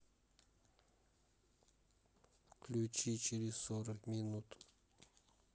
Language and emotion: Russian, neutral